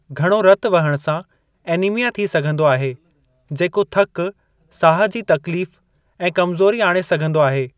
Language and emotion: Sindhi, neutral